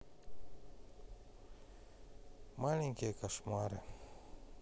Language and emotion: Russian, sad